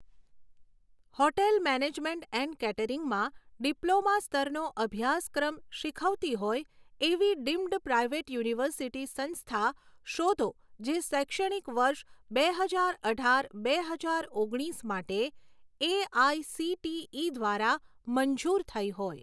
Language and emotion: Gujarati, neutral